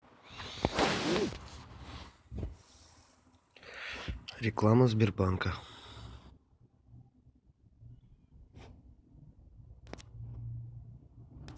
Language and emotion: Russian, neutral